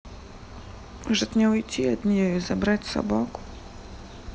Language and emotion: Russian, sad